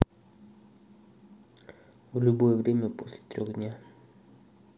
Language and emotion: Russian, neutral